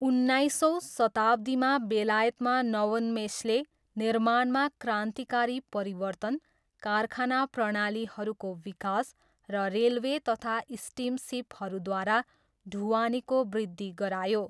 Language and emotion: Nepali, neutral